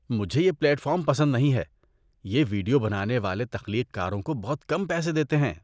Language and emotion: Urdu, disgusted